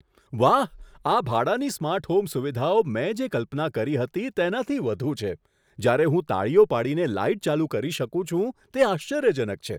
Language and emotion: Gujarati, surprised